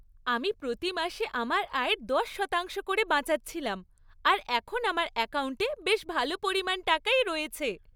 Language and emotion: Bengali, happy